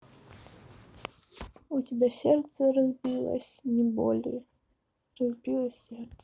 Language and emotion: Russian, sad